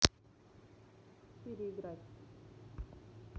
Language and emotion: Russian, neutral